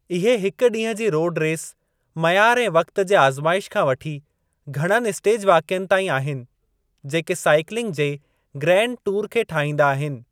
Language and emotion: Sindhi, neutral